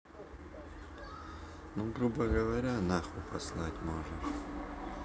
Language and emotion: Russian, neutral